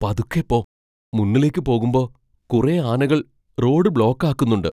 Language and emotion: Malayalam, fearful